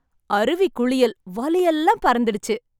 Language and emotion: Tamil, happy